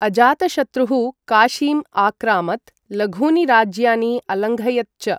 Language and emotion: Sanskrit, neutral